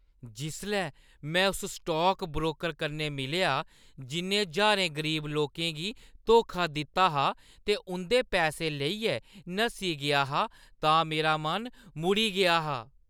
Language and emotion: Dogri, disgusted